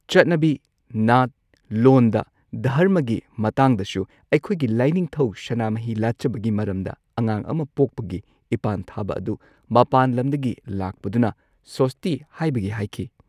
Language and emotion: Manipuri, neutral